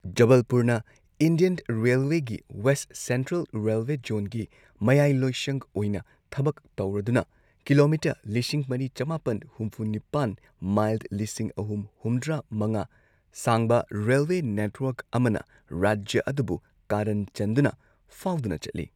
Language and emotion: Manipuri, neutral